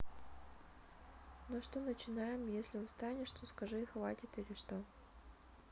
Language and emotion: Russian, neutral